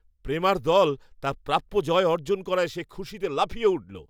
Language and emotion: Bengali, happy